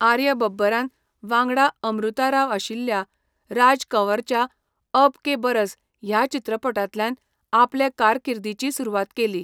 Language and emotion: Goan Konkani, neutral